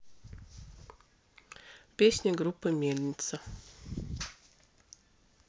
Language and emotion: Russian, neutral